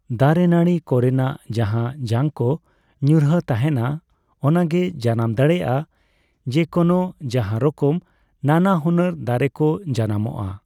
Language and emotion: Santali, neutral